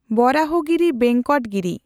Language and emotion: Santali, neutral